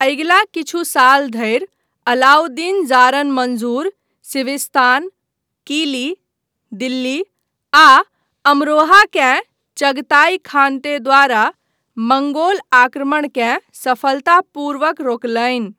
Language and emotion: Maithili, neutral